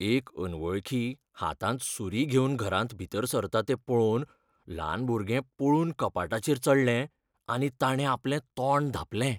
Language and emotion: Goan Konkani, fearful